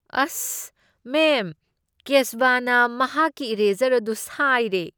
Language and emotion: Manipuri, disgusted